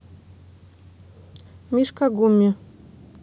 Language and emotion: Russian, neutral